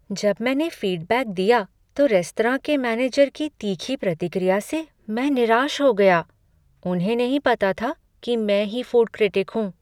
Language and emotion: Hindi, sad